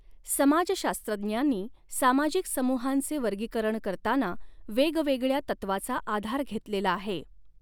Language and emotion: Marathi, neutral